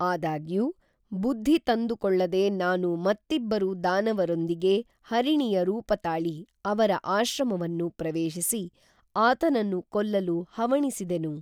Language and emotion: Kannada, neutral